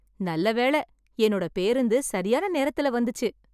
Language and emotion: Tamil, happy